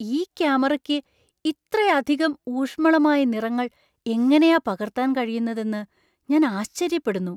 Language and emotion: Malayalam, surprised